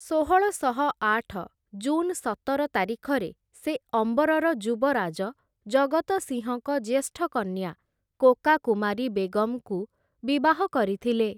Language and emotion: Odia, neutral